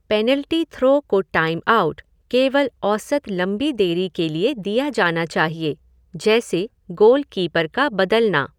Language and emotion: Hindi, neutral